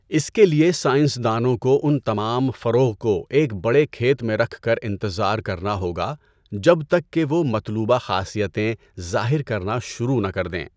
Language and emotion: Urdu, neutral